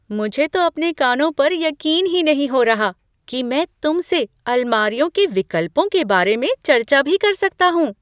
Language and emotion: Hindi, surprised